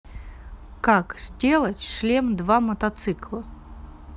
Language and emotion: Russian, neutral